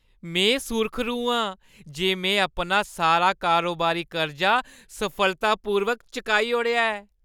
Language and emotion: Dogri, happy